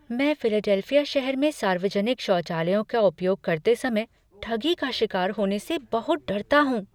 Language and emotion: Hindi, fearful